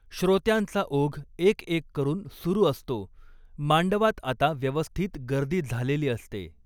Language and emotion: Marathi, neutral